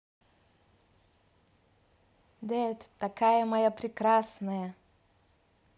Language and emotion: Russian, positive